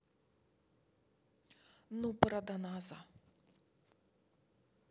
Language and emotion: Russian, neutral